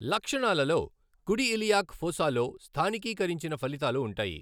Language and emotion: Telugu, neutral